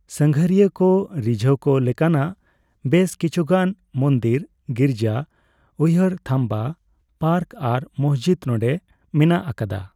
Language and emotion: Santali, neutral